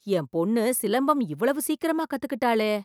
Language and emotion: Tamil, surprised